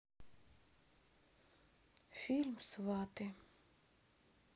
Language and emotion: Russian, sad